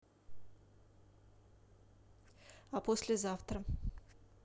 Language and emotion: Russian, neutral